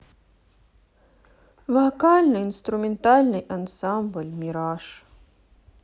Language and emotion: Russian, sad